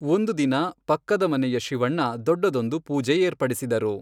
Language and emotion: Kannada, neutral